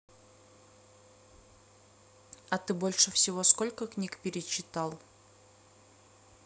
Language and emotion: Russian, neutral